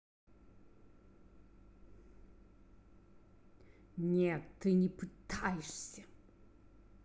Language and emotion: Russian, angry